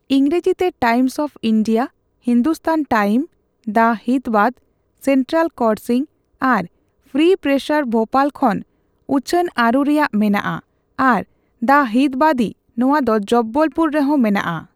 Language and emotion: Santali, neutral